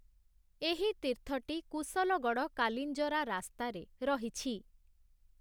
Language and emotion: Odia, neutral